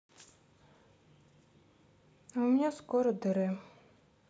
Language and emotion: Russian, sad